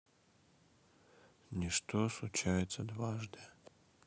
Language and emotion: Russian, sad